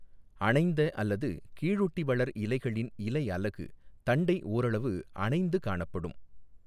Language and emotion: Tamil, neutral